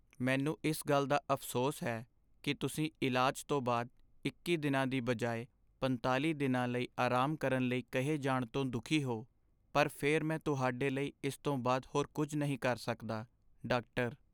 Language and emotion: Punjabi, sad